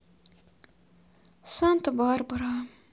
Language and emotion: Russian, sad